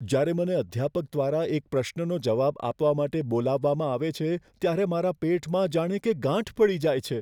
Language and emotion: Gujarati, fearful